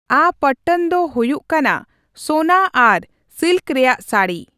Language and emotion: Santali, neutral